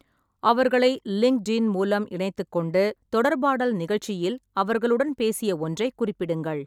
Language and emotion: Tamil, neutral